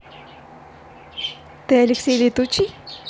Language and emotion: Russian, positive